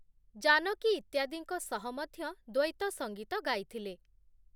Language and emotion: Odia, neutral